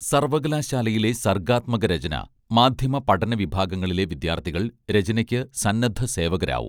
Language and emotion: Malayalam, neutral